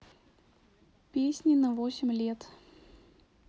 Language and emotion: Russian, neutral